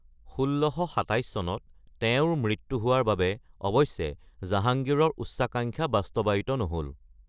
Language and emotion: Assamese, neutral